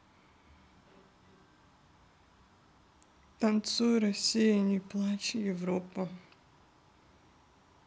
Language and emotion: Russian, neutral